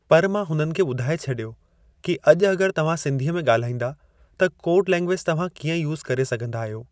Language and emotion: Sindhi, neutral